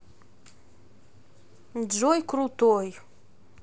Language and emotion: Russian, neutral